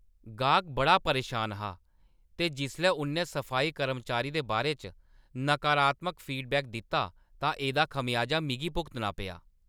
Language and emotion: Dogri, angry